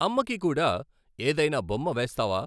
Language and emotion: Telugu, neutral